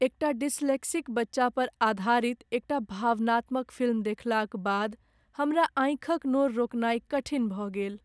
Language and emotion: Maithili, sad